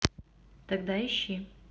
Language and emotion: Russian, neutral